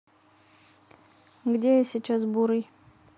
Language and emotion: Russian, neutral